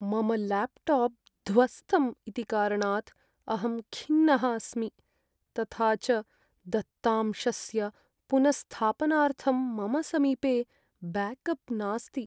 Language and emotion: Sanskrit, sad